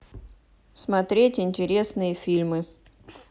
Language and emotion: Russian, neutral